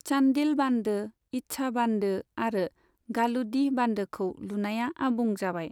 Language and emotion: Bodo, neutral